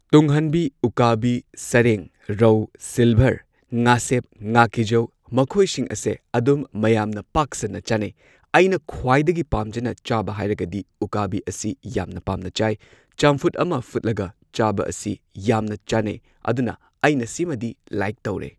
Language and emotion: Manipuri, neutral